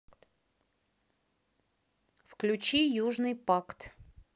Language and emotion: Russian, neutral